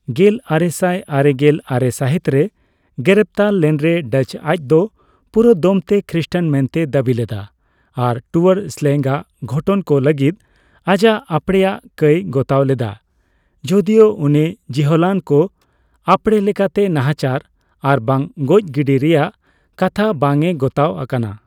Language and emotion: Santali, neutral